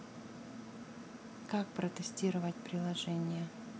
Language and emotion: Russian, neutral